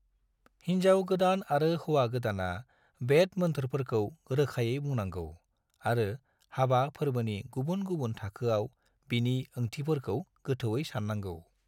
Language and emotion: Bodo, neutral